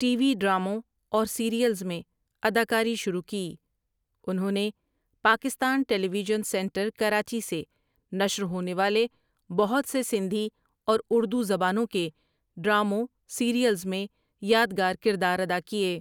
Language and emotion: Urdu, neutral